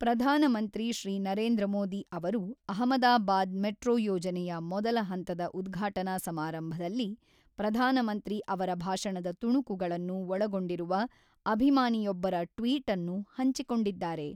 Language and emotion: Kannada, neutral